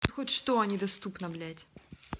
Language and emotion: Russian, angry